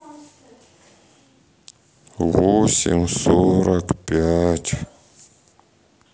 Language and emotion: Russian, sad